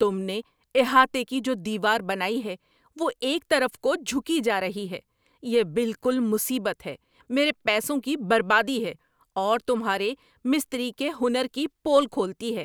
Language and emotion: Urdu, angry